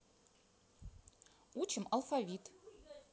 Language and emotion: Russian, neutral